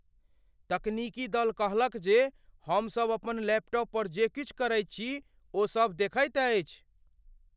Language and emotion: Maithili, fearful